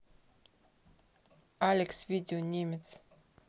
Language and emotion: Russian, neutral